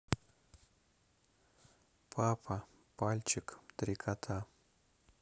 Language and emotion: Russian, neutral